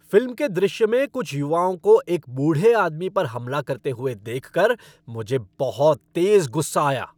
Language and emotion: Hindi, angry